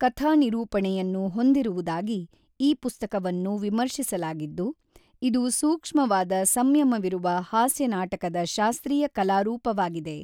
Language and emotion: Kannada, neutral